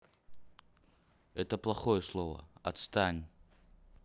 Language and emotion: Russian, neutral